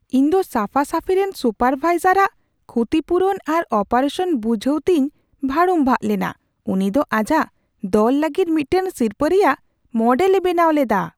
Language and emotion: Santali, surprised